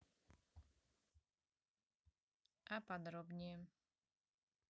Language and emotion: Russian, neutral